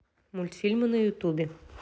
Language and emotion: Russian, neutral